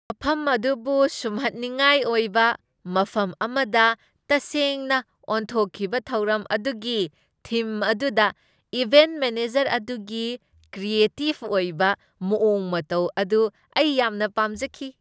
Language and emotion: Manipuri, happy